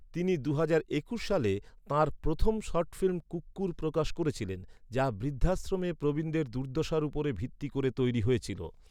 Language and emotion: Bengali, neutral